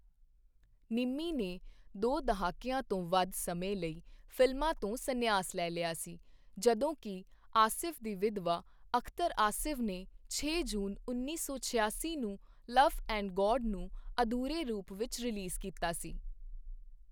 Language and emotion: Punjabi, neutral